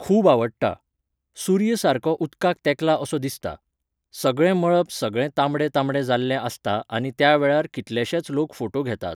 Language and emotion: Goan Konkani, neutral